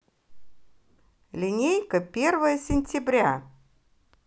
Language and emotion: Russian, positive